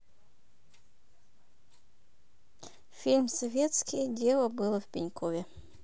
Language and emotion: Russian, neutral